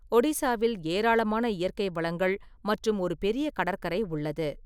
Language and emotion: Tamil, neutral